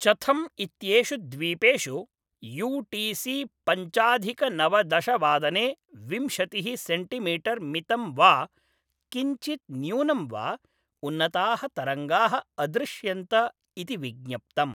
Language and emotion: Sanskrit, neutral